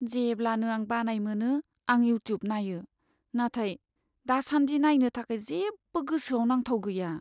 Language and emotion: Bodo, sad